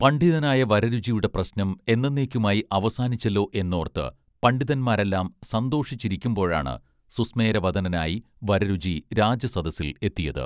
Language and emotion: Malayalam, neutral